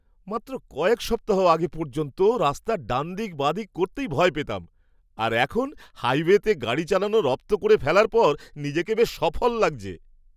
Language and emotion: Bengali, happy